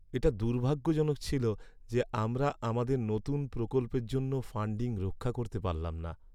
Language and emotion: Bengali, sad